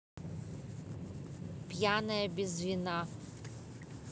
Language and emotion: Russian, neutral